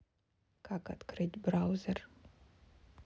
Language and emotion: Russian, neutral